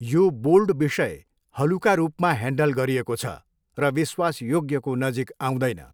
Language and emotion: Nepali, neutral